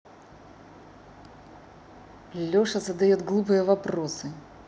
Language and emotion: Russian, angry